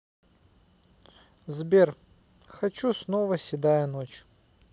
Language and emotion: Russian, neutral